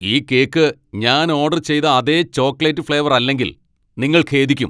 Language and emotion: Malayalam, angry